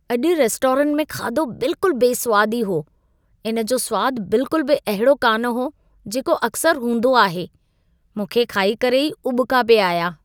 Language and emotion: Sindhi, disgusted